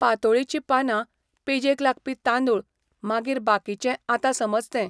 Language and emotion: Goan Konkani, neutral